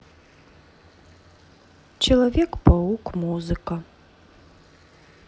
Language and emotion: Russian, neutral